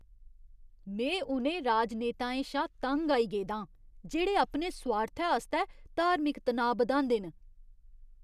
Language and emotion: Dogri, disgusted